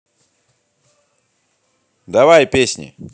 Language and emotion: Russian, positive